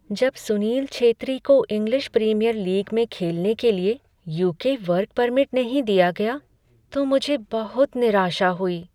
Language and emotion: Hindi, sad